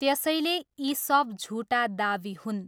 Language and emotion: Nepali, neutral